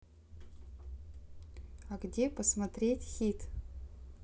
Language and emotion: Russian, neutral